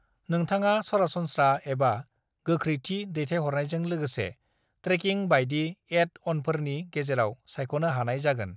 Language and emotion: Bodo, neutral